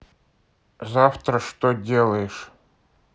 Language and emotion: Russian, neutral